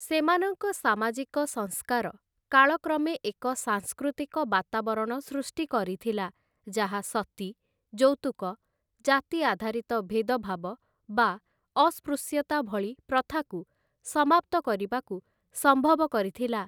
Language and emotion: Odia, neutral